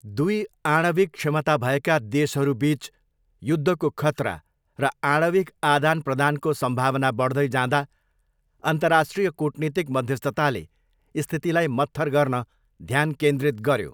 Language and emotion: Nepali, neutral